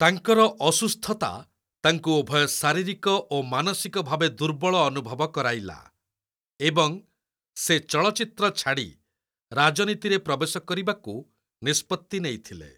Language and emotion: Odia, neutral